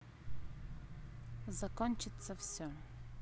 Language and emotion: Russian, neutral